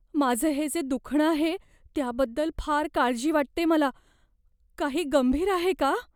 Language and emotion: Marathi, fearful